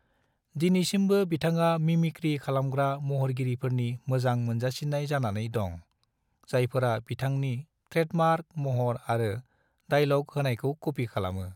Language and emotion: Bodo, neutral